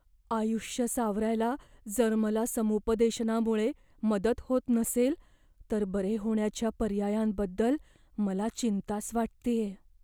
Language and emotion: Marathi, fearful